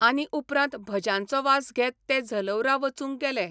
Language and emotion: Goan Konkani, neutral